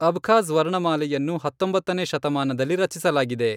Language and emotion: Kannada, neutral